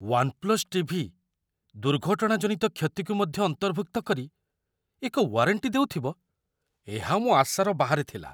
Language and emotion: Odia, surprised